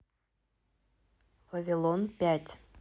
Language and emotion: Russian, neutral